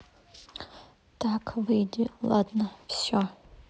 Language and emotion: Russian, neutral